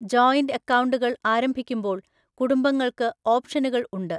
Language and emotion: Malayalam, neutral